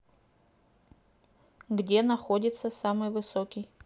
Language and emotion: Russian, neutral